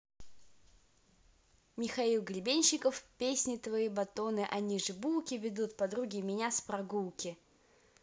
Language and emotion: Russian, positive